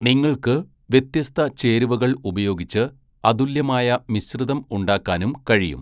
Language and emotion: Malayalam, neutral